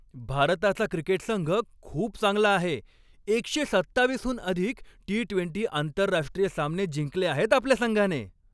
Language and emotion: Marathi, happy